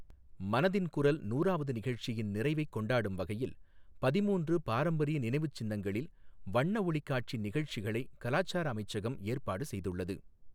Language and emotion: Tamil, neutral